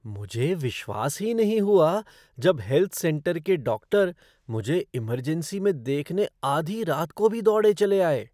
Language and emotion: Hindi, surprised